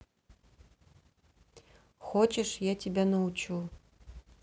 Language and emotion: Russian, neutral